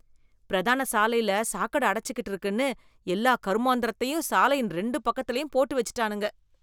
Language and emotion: Tamil, disgusted